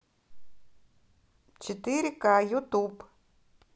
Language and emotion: Russian, neutral